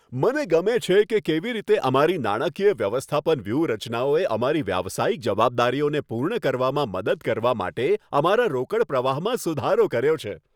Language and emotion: Gujarati, happy